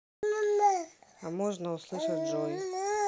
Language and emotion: Russian, neutral